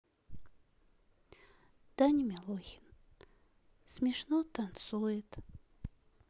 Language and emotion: Russian, sad